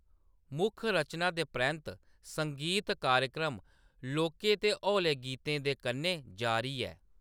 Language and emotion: Dogri, neutral